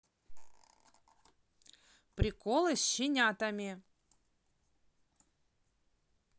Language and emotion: Russian, neutral